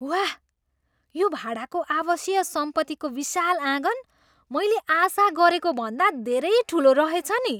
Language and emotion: Nepali, surprised